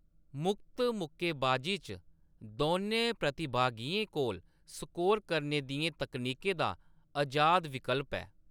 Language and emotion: Dogri, neutral